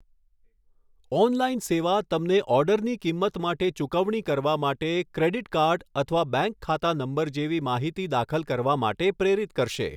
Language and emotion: Gujarati, neutral